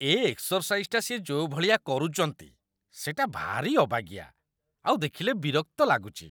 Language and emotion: Odia, disgusted